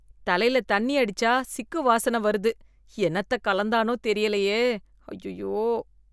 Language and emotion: Tamil, disgusted